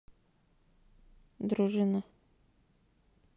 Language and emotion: Russian, neutral